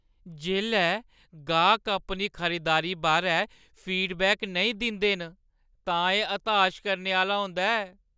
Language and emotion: Dogri, sad